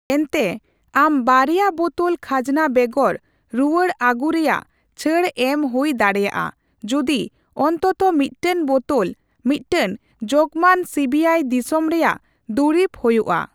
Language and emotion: Santali, neutral